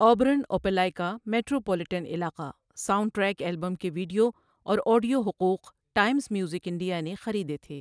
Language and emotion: Urdu, neutral